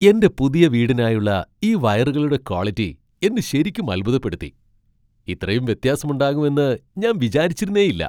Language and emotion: Malayalam, surprised